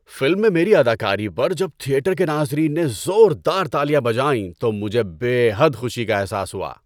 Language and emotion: Urdu, happy